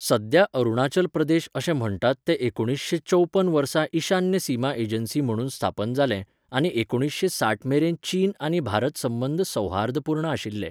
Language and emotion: Goan Konkani, neutral